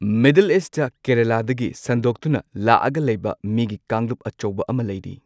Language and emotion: Manipuri, neutral